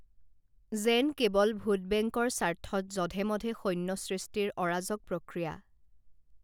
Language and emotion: Assamese, neutral